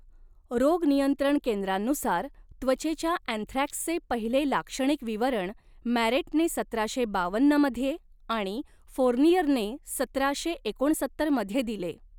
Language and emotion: Marathi, neutral